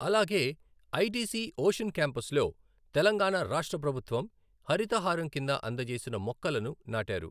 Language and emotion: Telugu, neutral